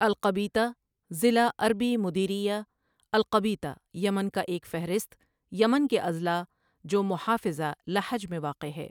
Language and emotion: Urdu, neutral